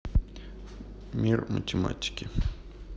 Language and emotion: Russian, neutral